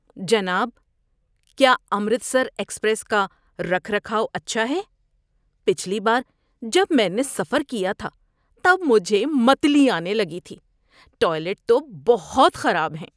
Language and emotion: Urdu, disgusted